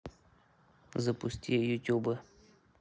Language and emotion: Russian, neutral